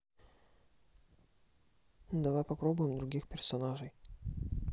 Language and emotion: Russian, neutral